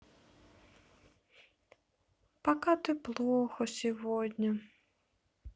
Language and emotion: Russian, sad